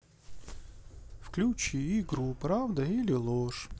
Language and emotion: Russian, neutral